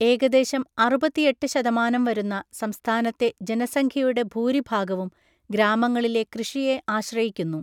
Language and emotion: Malayalam, neutral